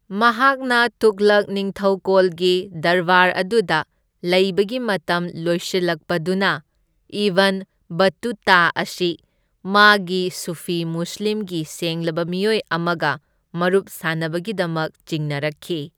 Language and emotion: Manipuri, neutral